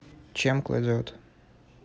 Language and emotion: Russian, neutral